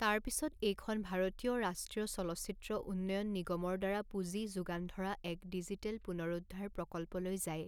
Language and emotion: Assamese, neutral